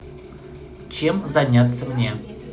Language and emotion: Russian, positive